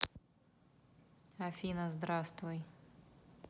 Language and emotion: Russian, neutral